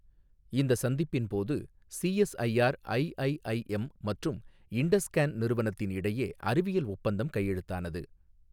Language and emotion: Tamil, neutral